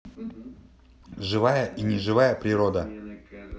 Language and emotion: Russian, neutral